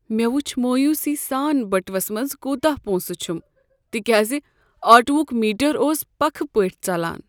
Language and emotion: Kashmiri, sad